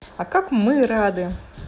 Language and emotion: Russian, positive